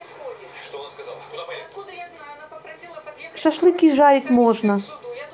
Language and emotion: Russian, neutral